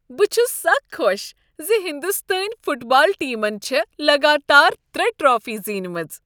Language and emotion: Kashmiri, happy